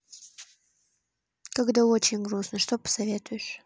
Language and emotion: Russian, neutral